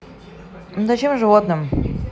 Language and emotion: Russian, neutral